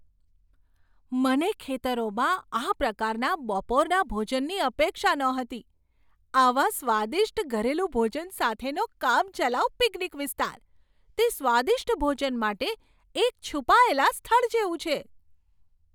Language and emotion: Gujarati, surprised